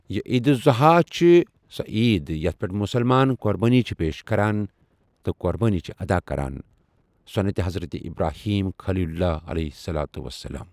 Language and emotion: Kashmiri, neutral